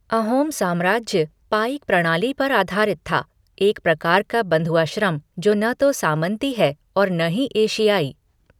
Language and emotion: Hindi, neutral